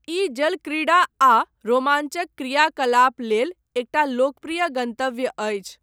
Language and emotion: Maithili, neutral